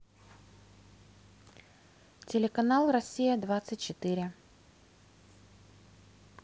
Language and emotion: Russian, neutral